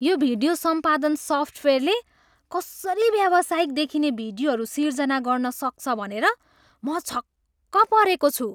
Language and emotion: Nepali, surprised